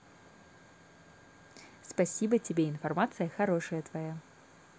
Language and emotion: Russian, positive